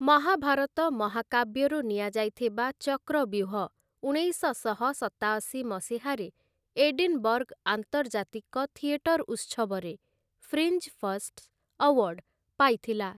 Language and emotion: Odia, neutral